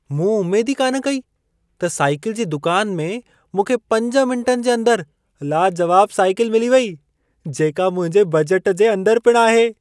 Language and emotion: Sindhi, surprised